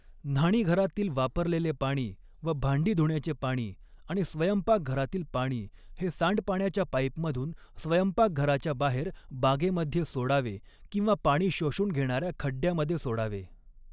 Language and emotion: Marathi, neutral